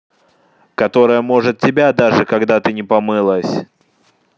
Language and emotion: Russian, angry